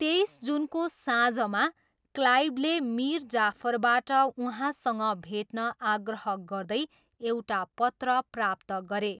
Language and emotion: Nepali, neutral